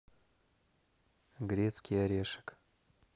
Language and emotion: Russian, neutral